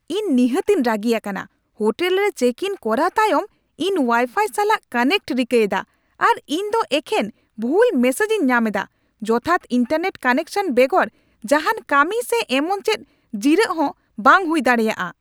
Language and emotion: Santali, angry